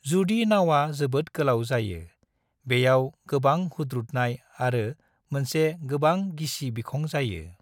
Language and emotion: Bodo, neutral